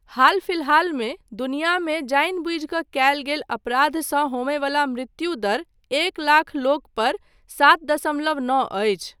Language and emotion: Maithili, neutral